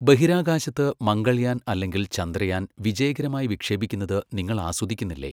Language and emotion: Malayalam, neutral